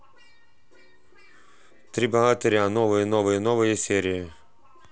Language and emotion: Russian, neutral